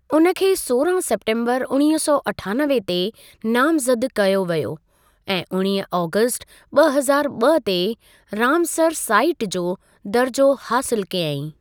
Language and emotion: Sindhi, neutral